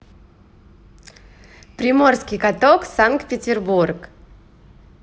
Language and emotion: Russian, positive